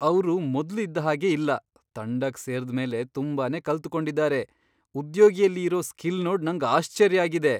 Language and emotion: Kannada, surprised